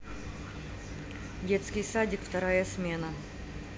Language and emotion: Russian, neutral